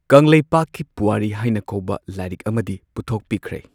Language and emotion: Manipuri, neutral